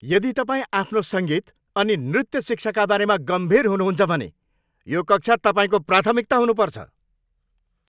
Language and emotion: Nepali, angry